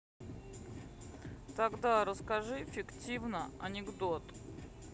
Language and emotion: Russian, neutral